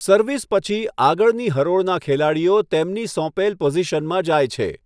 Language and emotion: Gujarati, neutral